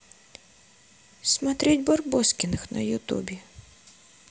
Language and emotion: Russian, sad